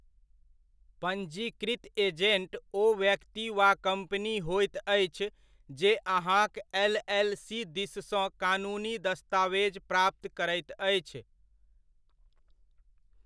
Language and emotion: Maithili, neutral